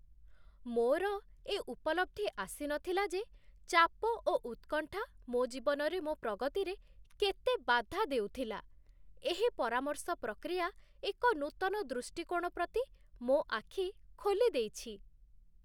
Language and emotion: Odia, surprised